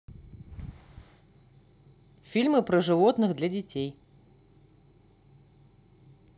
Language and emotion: Russian, neutral